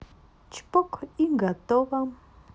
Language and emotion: Russian, positive